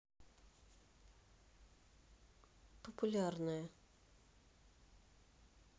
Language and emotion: Russian, neutral